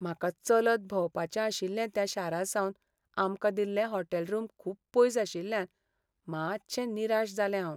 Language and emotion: Goan Konkani, sad